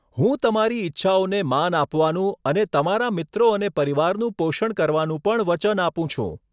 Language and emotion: Gujarati, neutral